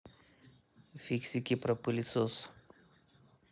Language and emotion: Russian, neutral